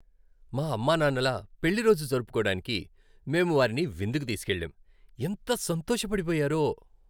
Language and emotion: Telugu, happy